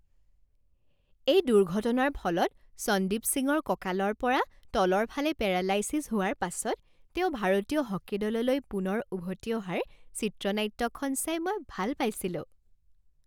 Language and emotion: Assamese, happy